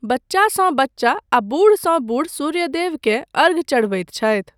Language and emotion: Maithili, neutral